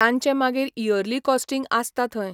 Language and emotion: Goan Konkani, neutral